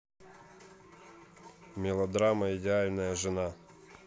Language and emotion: Russian, neutral